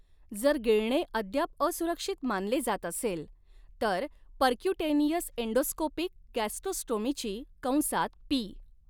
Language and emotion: Marathi, neutral